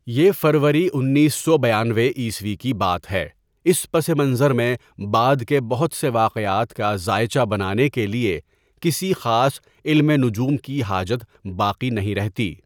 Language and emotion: Urdu, neutral